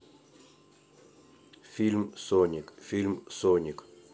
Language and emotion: Russian, neutral